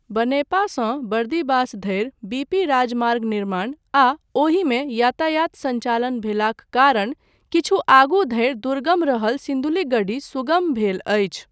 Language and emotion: Maithili, neutral